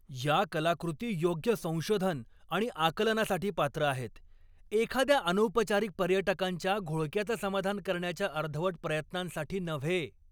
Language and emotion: Marathi, angry